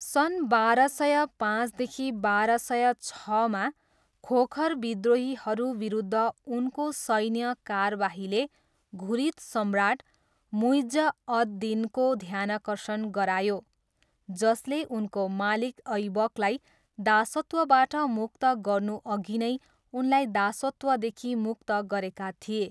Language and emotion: Nepali, neutral